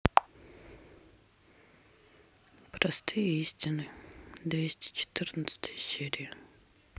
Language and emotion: Russian, sad